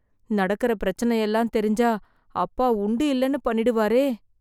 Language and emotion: Tamil, fearful